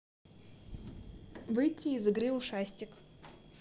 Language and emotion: Russian, neutral